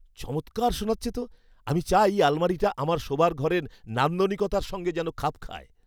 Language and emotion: Bengali, happy